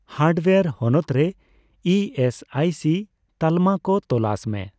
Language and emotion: Santali, neutral